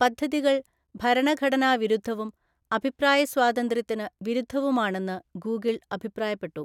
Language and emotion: Malayalam, neutral